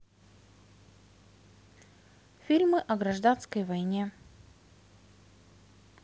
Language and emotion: Russian, neutral